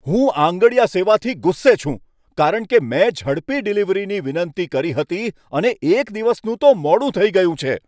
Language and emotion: Gujarati, angry